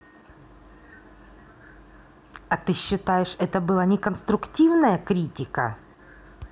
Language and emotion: Russian, angry